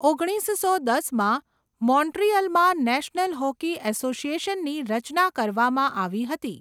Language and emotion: Gujarati, neutral